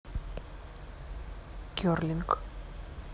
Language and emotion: Russian, neutral